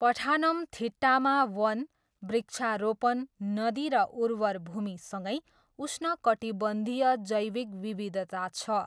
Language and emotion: Nepali, neutral